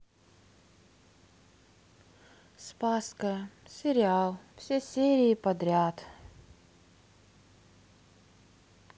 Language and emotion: Russian, sad